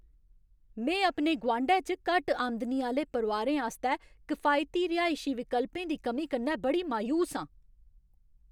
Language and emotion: Dogri, angry